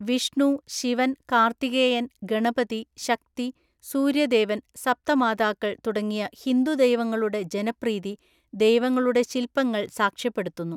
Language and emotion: Malayalam, neutral